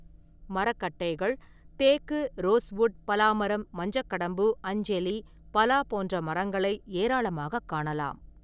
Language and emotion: Tamil, neutral